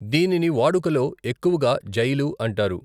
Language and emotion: Telugu, neutral